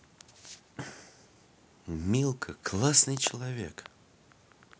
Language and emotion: Russian, positive